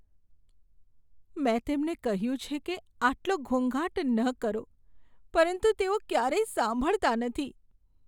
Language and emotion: Gujarati, sad